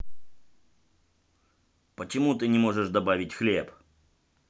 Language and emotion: Russian, angry